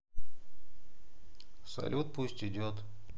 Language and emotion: Russian, sad